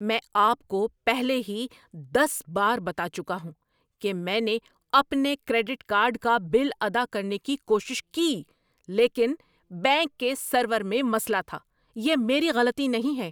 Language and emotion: Urdu, angry